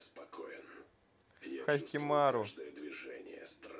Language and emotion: Russian, neutral